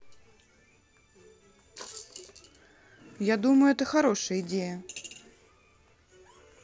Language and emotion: Russian, neutral